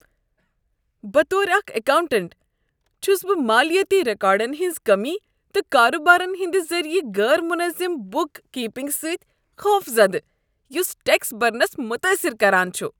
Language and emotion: Kashmiri, disgusted